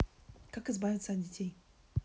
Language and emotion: Russian, neutral